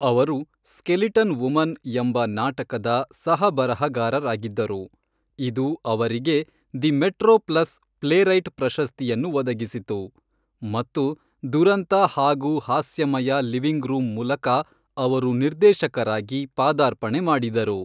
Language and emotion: Kannada, neutral